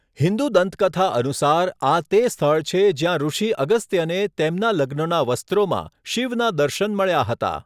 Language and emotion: Gujarati, neutral